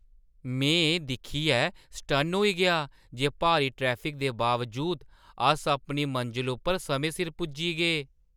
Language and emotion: Dogri, surprised